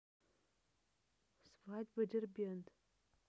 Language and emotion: Russian, neutral